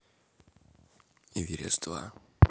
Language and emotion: Russian, neutral